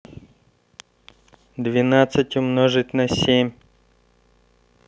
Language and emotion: Russian, neutral